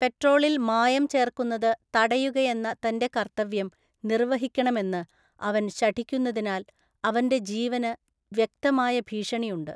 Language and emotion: Malayalam, neutral